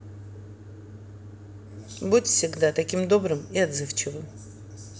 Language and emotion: Russian, neutral